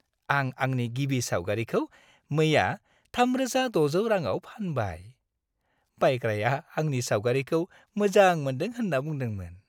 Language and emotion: Bodo, happy